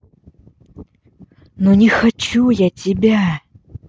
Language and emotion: Russian, angry